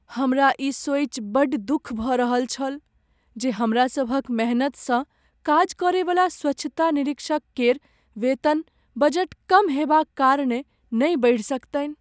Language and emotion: Maithili, sad